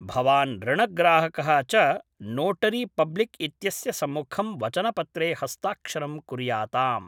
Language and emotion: Sanskrit, neutral